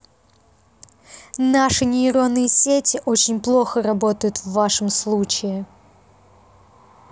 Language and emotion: Russian, neutral